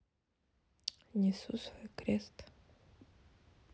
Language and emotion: Russian, sad